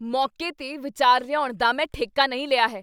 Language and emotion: Punjabi, angry